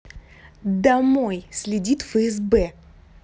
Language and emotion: Russian, angry